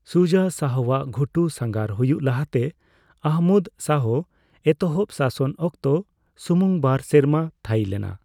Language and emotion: Santali, neutral